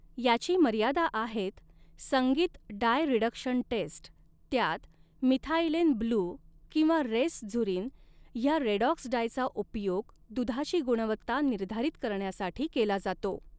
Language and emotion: Marathi, neutral